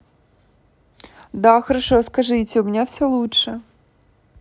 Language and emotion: Russian, positive